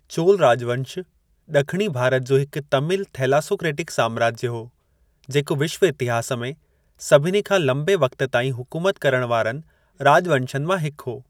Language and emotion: Sindhi, neutral